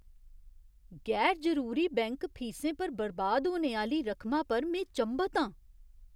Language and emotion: Dogri, surprised